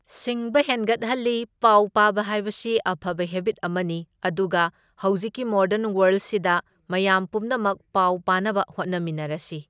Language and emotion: Manipuri, neutral